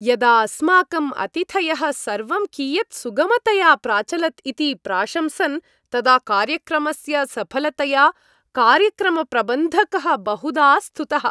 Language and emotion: Sanskrit, happy